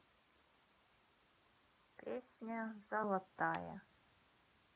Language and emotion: Russian, neutral